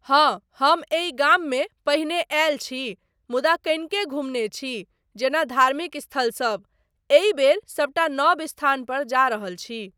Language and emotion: Maithili, neutral